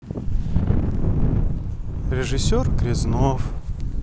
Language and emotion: Russian, sad